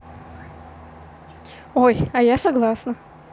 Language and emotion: Russian, positive